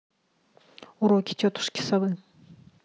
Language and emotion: Russian, neutral